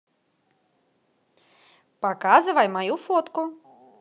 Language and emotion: Russian, positive